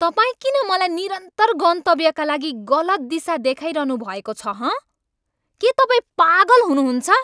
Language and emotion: Nepali, angry